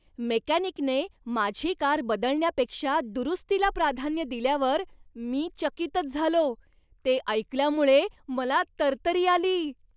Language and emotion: Marathi, surprised